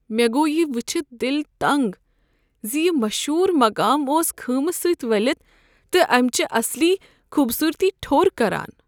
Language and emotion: Kashmiri, sad